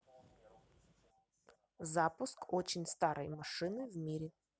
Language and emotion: Russian, neutral